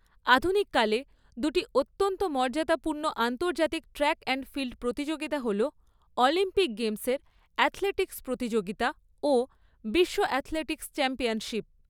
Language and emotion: Bengali, neutral